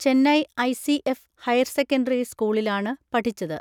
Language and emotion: Malayalam, neutral